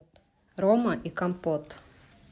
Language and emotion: Russian, neutral